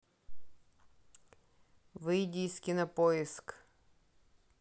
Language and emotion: Russian, neutral